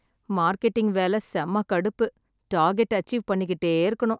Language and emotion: Tamil, sad